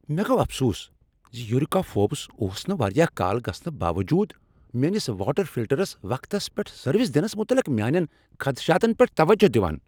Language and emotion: Kashmiri, angry